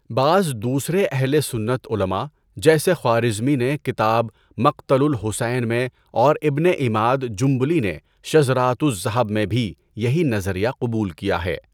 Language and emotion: Urdu, neutral